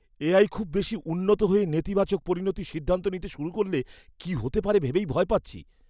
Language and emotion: Bengali, fearful